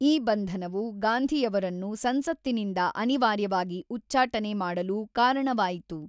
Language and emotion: Kannada, neutral